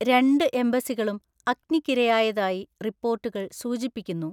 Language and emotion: Malayalam, neutral